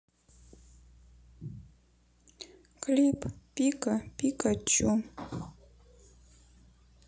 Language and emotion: Russian, sad